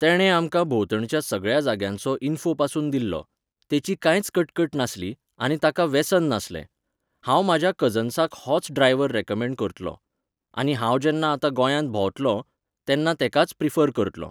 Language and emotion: Goan Konkani, neutral